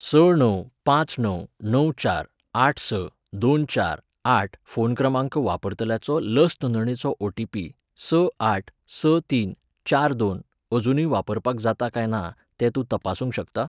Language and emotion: Goan Konkani, neutral